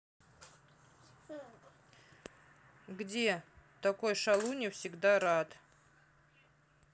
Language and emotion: Russian, neutral